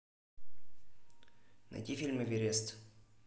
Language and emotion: Russian, neutral